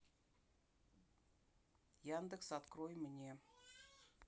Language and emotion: Russian, neutral